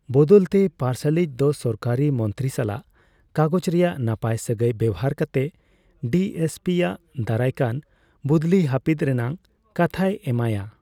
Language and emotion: Santali, neutral